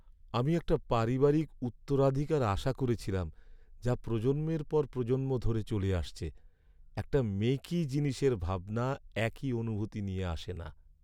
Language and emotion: Bengali, sad